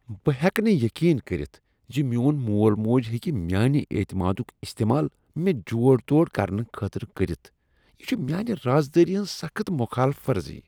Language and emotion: Kashmiri, disgusted